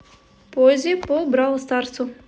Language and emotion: Russian, neutral